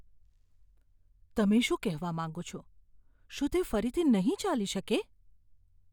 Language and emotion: Gujarati, fearful